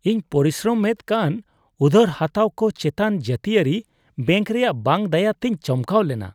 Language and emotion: Santali, disgusted